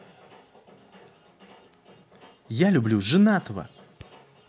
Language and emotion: Russian, neutral